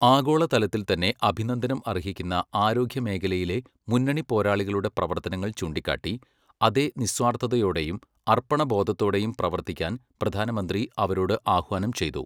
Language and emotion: Malayalam, neutral